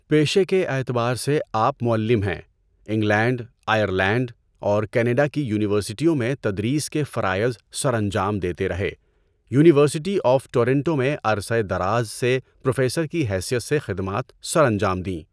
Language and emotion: Urdu, neutral